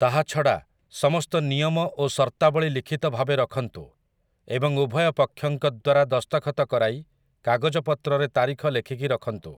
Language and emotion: Odia, neutral